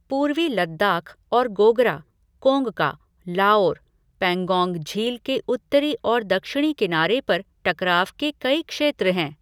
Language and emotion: Hindi, neutral